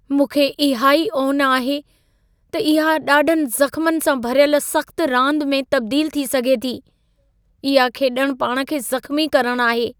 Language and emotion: Sindhi, fearful